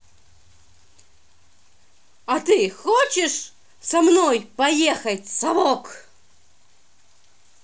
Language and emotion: Russian, angry